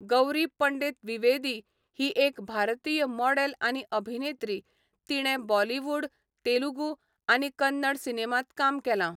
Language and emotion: Goan Konkani, neutral